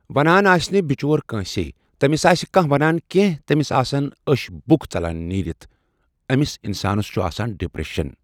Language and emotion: Kashmiri, neutral